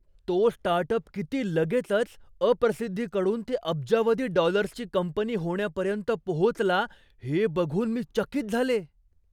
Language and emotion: Marathi, surprised